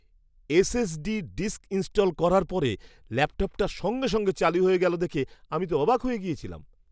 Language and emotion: Bengali, surprised